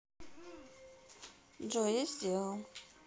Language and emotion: Russian, neutral